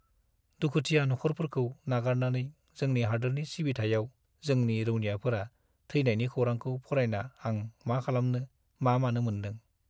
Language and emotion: Bodo, sad